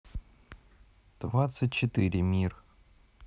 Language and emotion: Russian, neutral